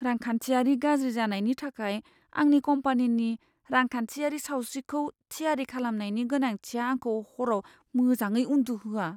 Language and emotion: Bodo, fearful